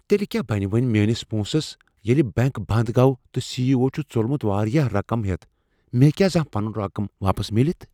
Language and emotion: Kashmiri, fearful